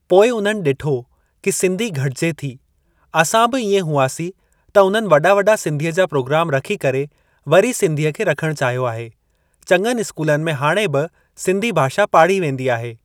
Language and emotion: Sindhi, neutral